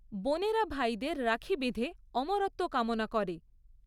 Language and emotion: Bengali, neutral